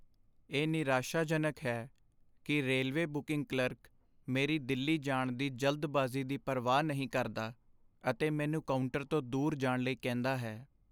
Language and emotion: Punjabi, sad